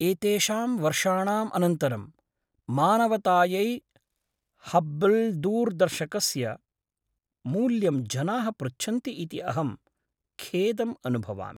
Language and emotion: Sanskrit, sad